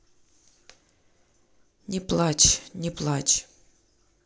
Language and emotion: Russian, neutral